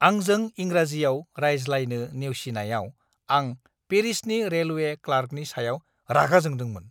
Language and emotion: Bodo, angry